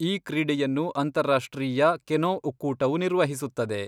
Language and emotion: Kannada, neutral